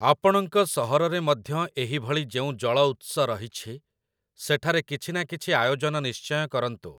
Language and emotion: Odia, neutral